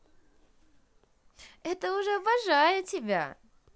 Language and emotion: Russian, positive